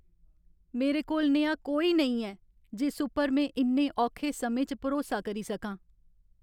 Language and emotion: Dogri, sad